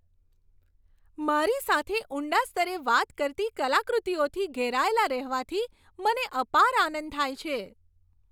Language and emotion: Gujarati, happy